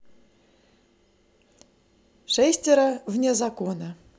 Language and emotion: Russian, positive